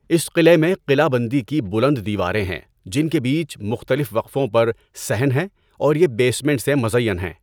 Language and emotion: Urdu, neutral